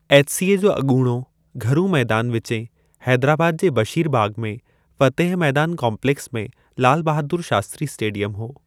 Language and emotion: Sindhi, neutral